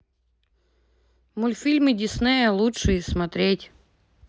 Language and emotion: Russian, neutral